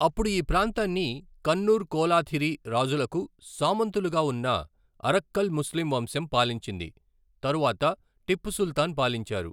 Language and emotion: Telugu, neutral